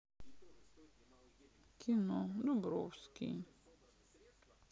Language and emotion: Russian, sad